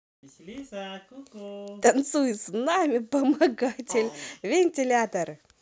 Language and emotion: Russian, positive